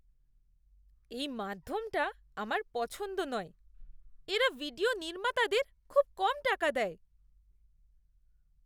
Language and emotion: Bengali, disgusted